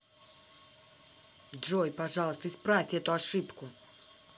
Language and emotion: Russian, angry